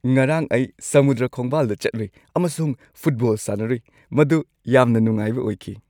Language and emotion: Manipuri, happy